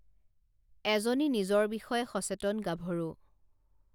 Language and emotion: Assamese, neutral